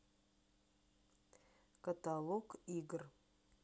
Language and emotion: Russian, neutral